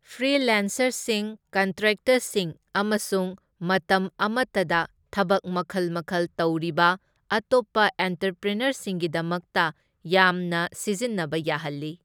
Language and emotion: Manipuri, neutral